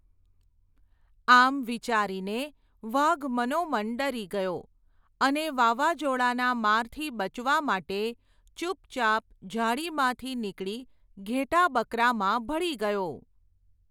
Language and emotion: Gujarati, neutral